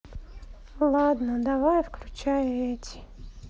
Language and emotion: Russian, sad